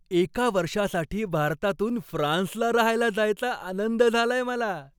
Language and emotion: Marathi, happy